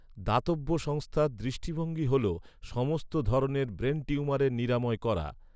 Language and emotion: Bengali, neutral